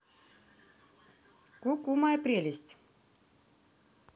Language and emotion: Russian, positive